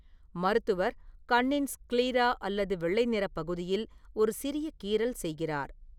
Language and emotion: Tamil, neutral